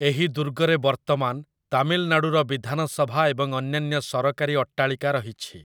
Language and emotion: Odia, neutral